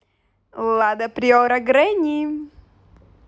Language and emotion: Russian, positive